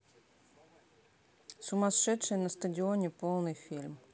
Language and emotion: Russian, neutral